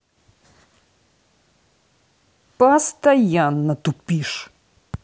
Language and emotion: Russian, angry